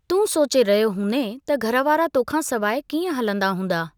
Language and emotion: Sindhi, neutral